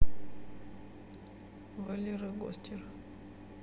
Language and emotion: Russian, neutral